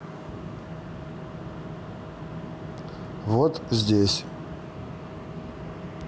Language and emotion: Russian, neutral